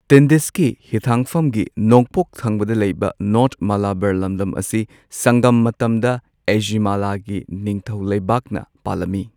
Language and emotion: Manipuri, neutral